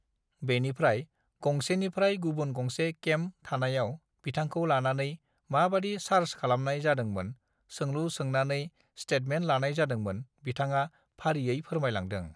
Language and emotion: Bodo, neutral